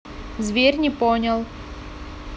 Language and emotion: Russian, neutral